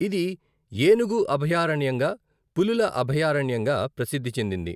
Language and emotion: Telugu, neutral